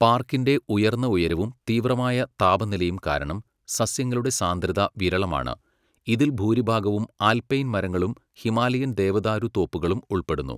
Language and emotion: Malayalam, neutral